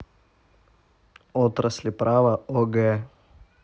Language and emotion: Russian, neutral